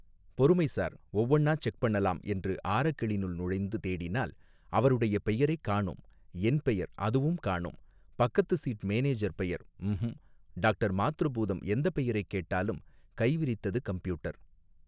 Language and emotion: Tamil, neutral